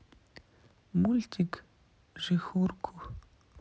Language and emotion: Russian, neutral